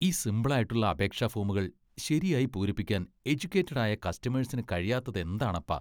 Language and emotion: Malayalam, disgusted